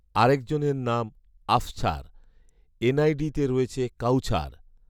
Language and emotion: Bengali, neutral